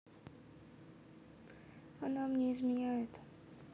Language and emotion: Russian, sad